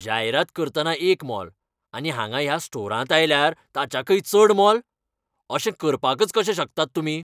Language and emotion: Goan Konkani, angry